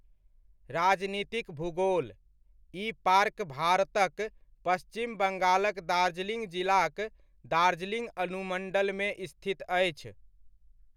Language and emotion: Maithili, neutral